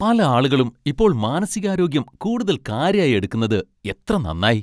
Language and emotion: Malayalam, happy